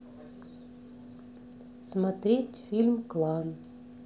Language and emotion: Russian, neutral